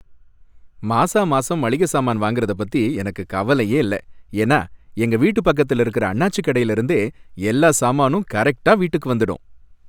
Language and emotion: Tamil, happy